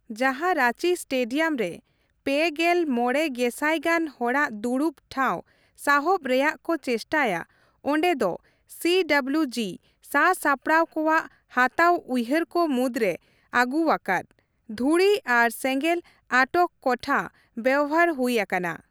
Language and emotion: Santali, neutral